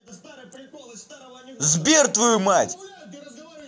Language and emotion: Russian, angry